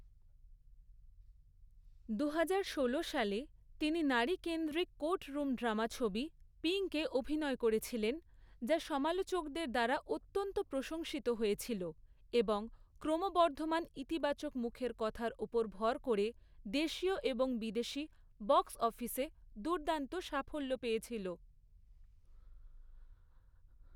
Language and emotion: Bengali, neutral